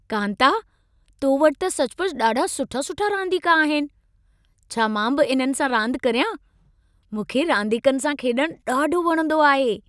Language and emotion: Sindhi, happy